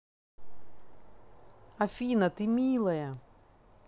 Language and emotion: Russian, positive